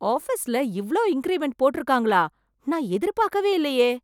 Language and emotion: Tamil, surprised